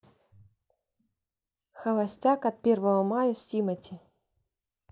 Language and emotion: Russian, neutral